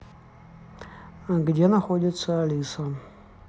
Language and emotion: Russian, neutral